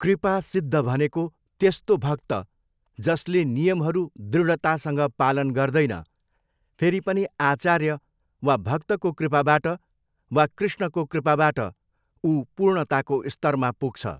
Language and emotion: Nepali, neutral